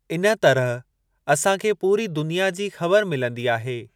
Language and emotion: Sindhi, neutral